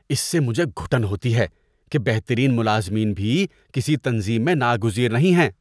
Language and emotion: Urdu, disgusted